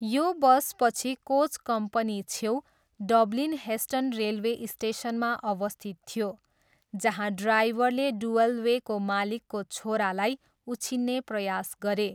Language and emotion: Nepali, neutral